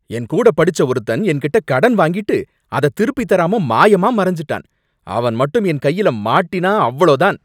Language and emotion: Tamil, angry